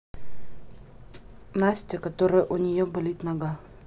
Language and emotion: Russian, neutral